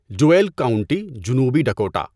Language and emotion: Urdu, neutral